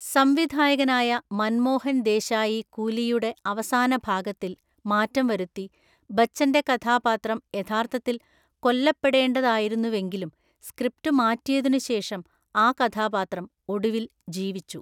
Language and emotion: Malayalam, neutral